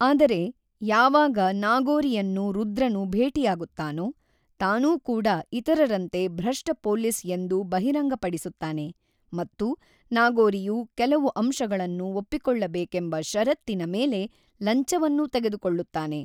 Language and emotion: Kannada, neutral